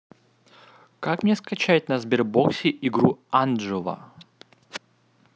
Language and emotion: Russian, neutral